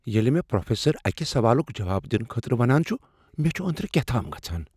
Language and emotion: Kashmiri, fearful